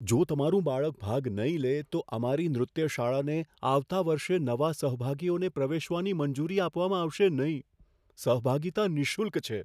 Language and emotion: Gujarati, fearful